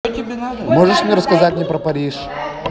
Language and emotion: Russian, positive